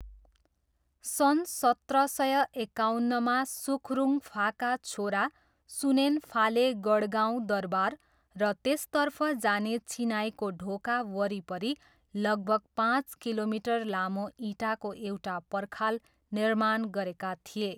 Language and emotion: Nepali, neutral